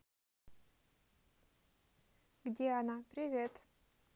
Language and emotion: Russian, neutral